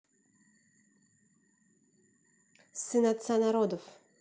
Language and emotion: Russian, neutral